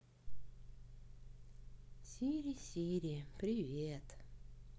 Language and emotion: Russian, neutral